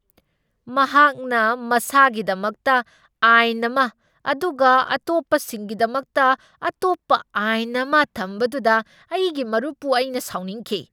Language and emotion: Manipuri, angry